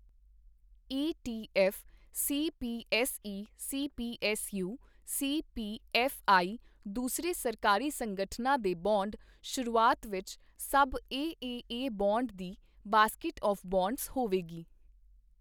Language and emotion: Punjabi, neutral